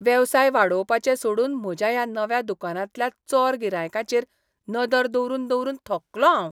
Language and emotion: Goan Konkani, disgusted